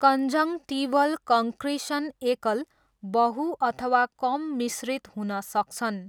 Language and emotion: Nepali, neutral